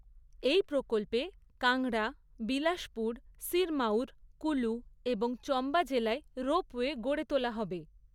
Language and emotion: Bengali, neutral